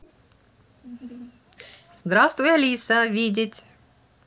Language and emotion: Russian, positive